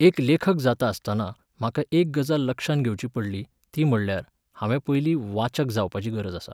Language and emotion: Goan Konkani, neutral